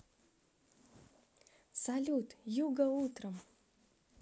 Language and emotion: Russian, positive